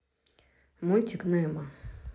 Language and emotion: Russian, neutral